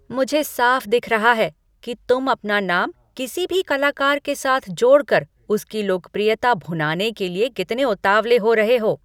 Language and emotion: Hindi, angry